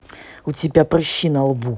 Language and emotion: Russian, angry